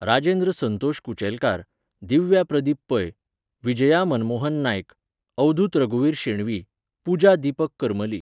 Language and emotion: Goan Konkani, neutral